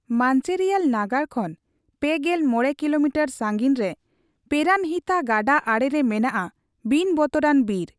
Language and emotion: Santali, neutral